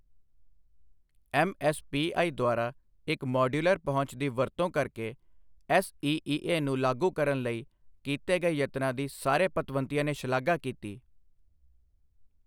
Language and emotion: Punjabi, neutral